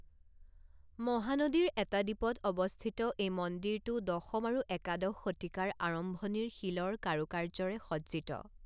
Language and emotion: Assamese, neutral